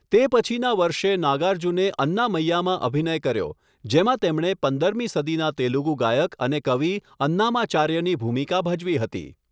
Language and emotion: Gujarati, neutral